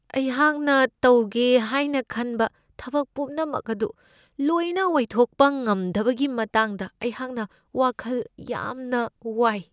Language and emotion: Manipuri, fearful